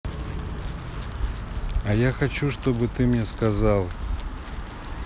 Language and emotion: Russian, neutral